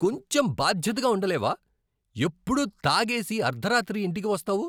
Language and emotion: Telugu, angry